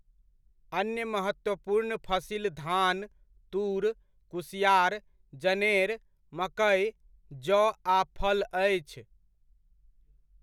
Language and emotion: Maithili, neutral